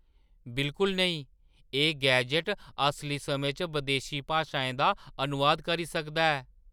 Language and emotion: Dogri, surprised